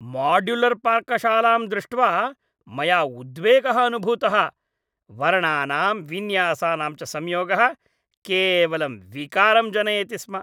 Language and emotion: Sanskrit, disgusted